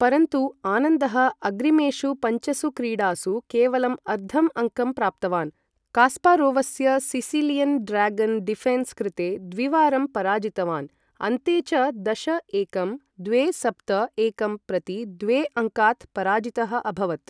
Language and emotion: Sanskrit, neutral